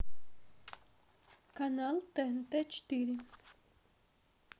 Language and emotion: Russian, neutral